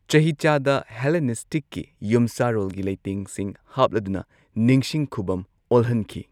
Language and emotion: Manipuri, neutral